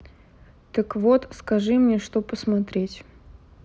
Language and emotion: Russian, neutral